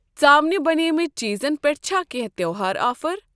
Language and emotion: Kashmiri, neutral